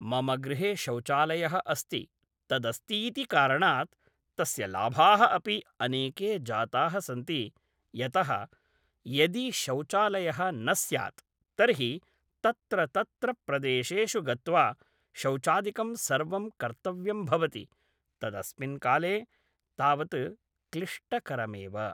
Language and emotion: Sanskrit, neutral